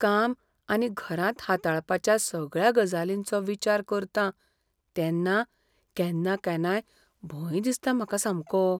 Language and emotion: Goan Konkani, fearful